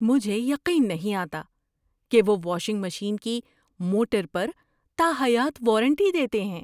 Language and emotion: Urdu, surprised